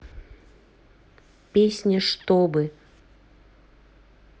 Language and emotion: Russian, neutral